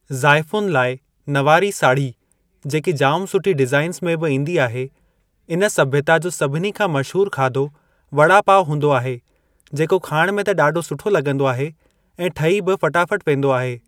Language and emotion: Sindhi, neutral